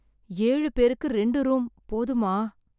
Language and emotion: Tamil, sad